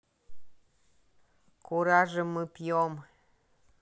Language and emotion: Russian, neutral